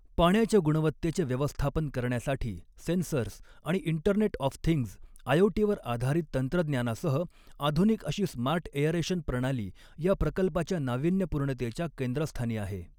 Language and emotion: Marathi, neutral